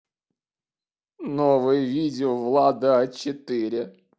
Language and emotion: Russian, sad